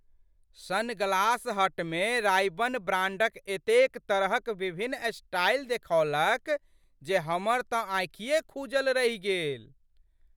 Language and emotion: Maithili, surprised